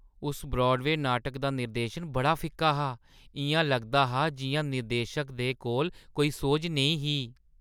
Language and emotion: Dogri, disgusted